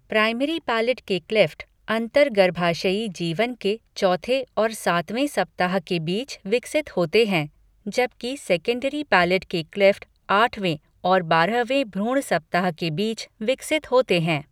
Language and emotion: Hindi, neutral